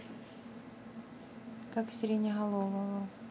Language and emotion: Russian, neutral